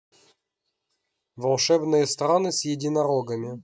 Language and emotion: Russian, neutral